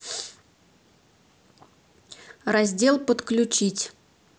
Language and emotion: Russian, neutral